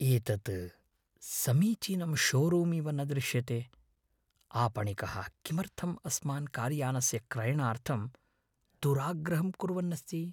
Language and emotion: Sanskrit, fearful